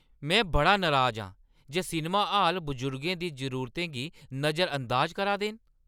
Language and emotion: Dogri, angry